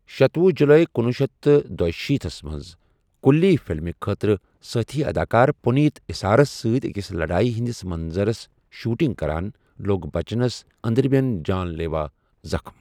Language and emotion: Kashmiri, neutral